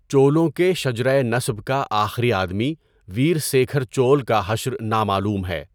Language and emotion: Urdu, neutral